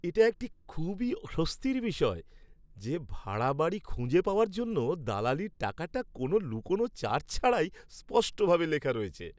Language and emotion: Bengali, happy